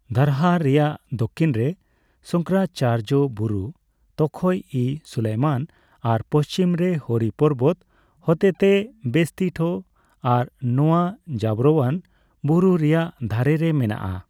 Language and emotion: Santali, neutral